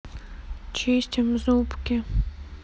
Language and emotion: Russian, sad